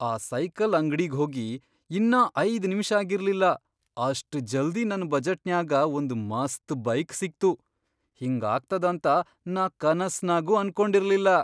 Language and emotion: Kannada, surprised